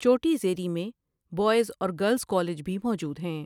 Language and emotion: Urdu, neutral